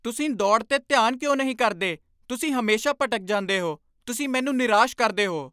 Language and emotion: Punjabi, angry